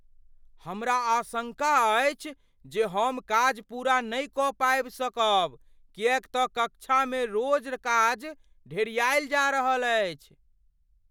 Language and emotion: Maithili, fearful